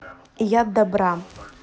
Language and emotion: Russian, neutral